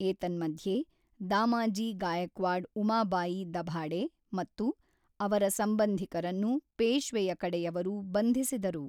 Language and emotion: Kannada, neutral